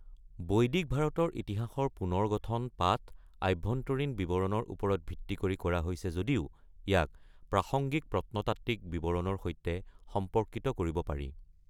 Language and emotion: Assamese, neutral